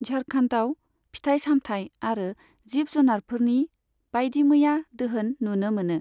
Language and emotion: Bodo, neutral